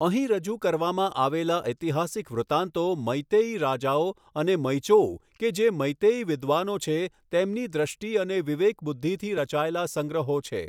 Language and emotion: Gujarati, neutral